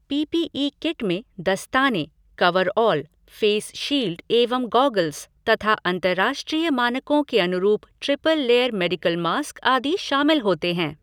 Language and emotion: Hindi, neutral